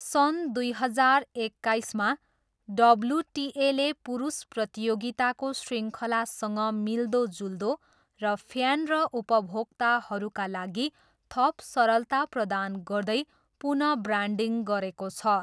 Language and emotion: Nepali, neutral